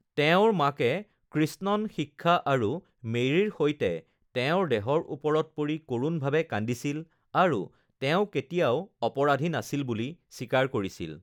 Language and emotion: Assamese, neutral